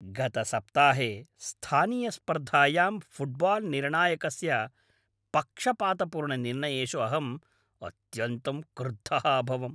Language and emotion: Sanskrit, angry